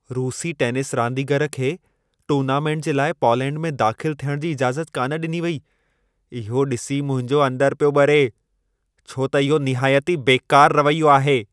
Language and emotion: Sindhi, angry